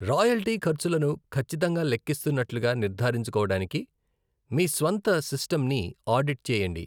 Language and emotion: Telugu, neutral